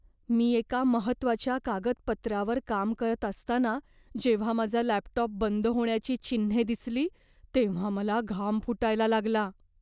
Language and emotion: Marathi, fearful